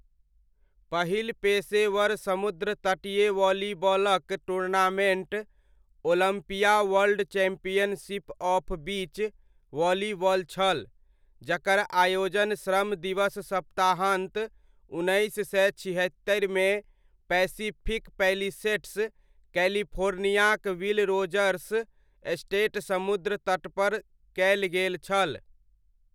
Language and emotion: Maithili, neutral